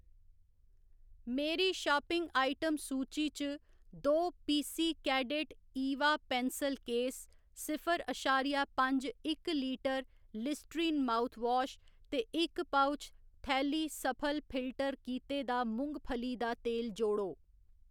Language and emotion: Dogri, neutral